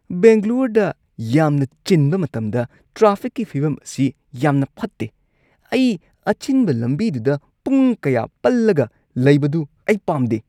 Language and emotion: Manipuri, disgusted